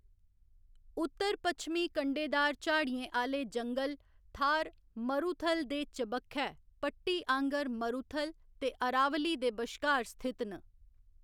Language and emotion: Dogri, neutral